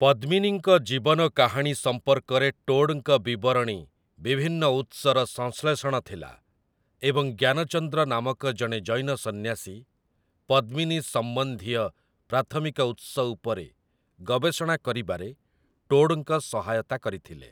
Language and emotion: Odia, neutral